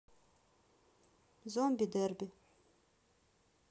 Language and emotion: Russian, neutral